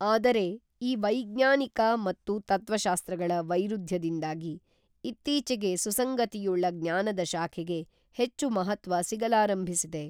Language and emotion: Kannada, neutral